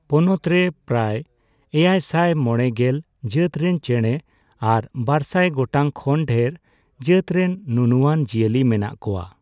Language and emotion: Santali, neutral